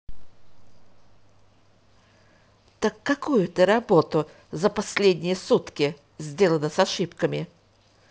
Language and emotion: Russian, angry